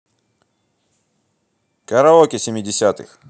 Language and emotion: Russian, positive